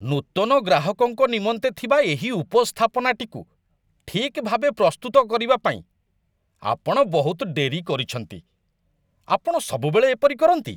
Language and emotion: Odia, disgusted